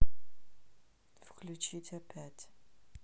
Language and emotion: Russian, neutral